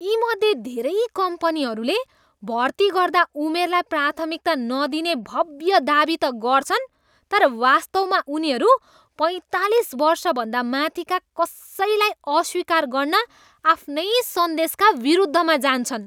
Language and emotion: Nepali, disgusted